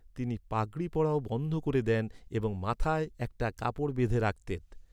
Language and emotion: Bengali, neutral